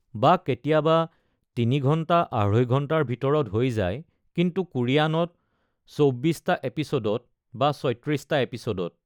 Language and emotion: Assamese, neutral